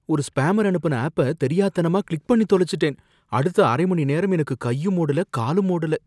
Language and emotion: Tamil, fearful